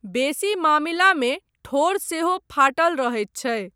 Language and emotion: Maithili, neutral